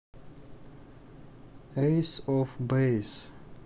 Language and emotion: Russian, neutral